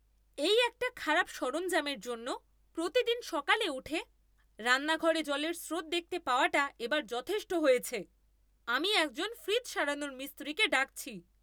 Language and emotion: Bengali, angry